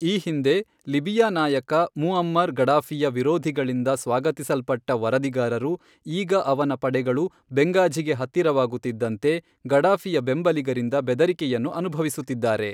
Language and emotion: Kannada, neutral